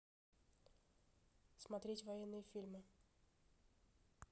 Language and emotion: Russian, neutral